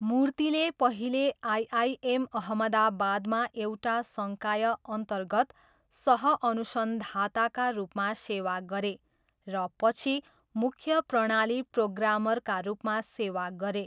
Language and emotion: Nepali, neutral